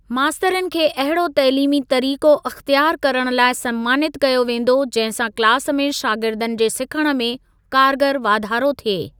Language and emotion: Sindhi, neutral